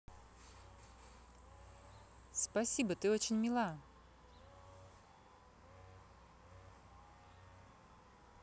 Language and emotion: Russian, positive